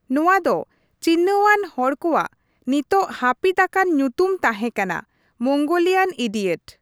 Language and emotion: Santali, neutral